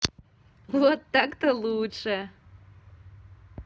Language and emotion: Russian, positive